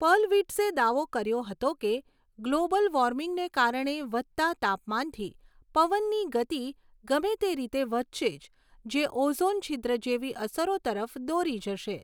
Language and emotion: Gujarati, neutral